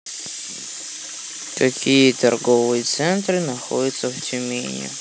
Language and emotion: Russian, sad